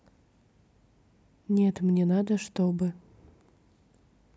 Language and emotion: Russian, neutral